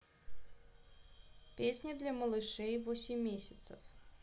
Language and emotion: Russian, neutral